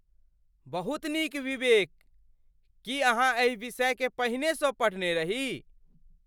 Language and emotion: Maithili, surprised